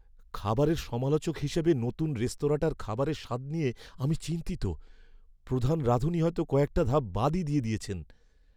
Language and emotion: Bengali, fearful